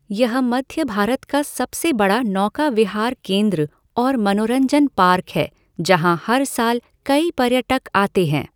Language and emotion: Hindi, neutral